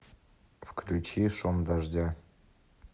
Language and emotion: Russian, neutral